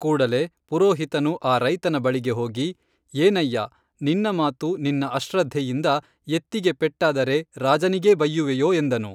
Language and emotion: Kannada, neutral